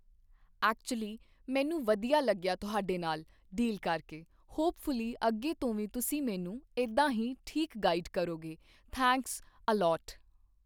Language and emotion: Punjabi, neutral